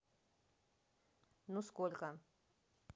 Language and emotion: Russian, neutral